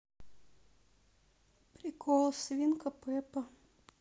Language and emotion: Russian, sad